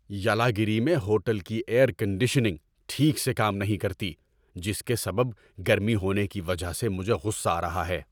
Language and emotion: Urdu, angry